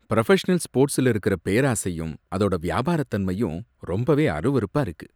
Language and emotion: Tamil, disgusted